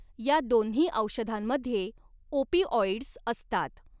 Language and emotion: Marathi, neutral